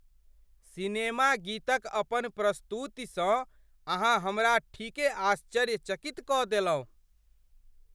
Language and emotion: Maithili, surprised